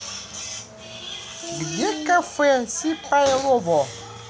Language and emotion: Russian, positive